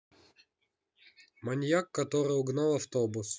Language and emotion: Russian, neutral